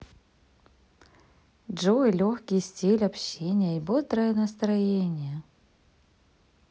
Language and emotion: Russian, positive